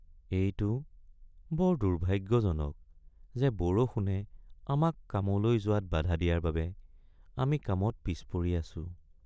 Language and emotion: Assamese, sad